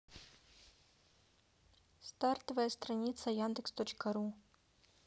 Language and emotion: Russian, neutral